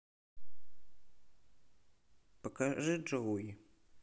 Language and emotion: Russian, neutral